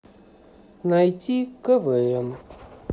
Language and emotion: Russian, neutral